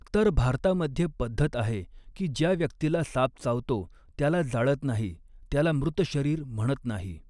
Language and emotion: Marathi, neutral